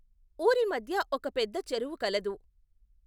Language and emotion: Telugu, neutral